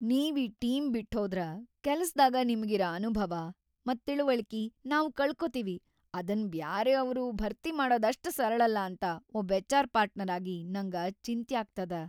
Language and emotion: Kannada, fearful